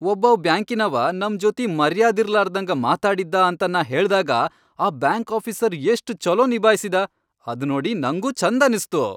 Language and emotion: Kannada, happy